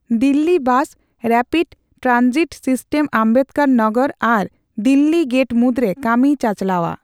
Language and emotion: Santali, neutral